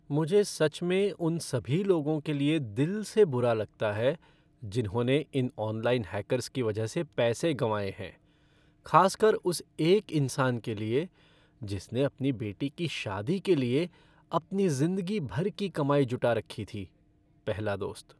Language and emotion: Hindi, sad